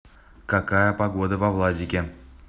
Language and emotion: Russian, neutral